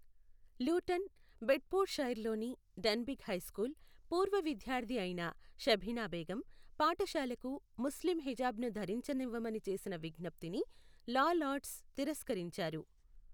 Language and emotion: Telugu, neutral